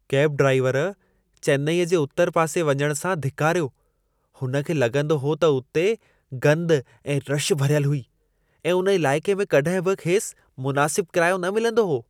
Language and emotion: Sindhi, disgusted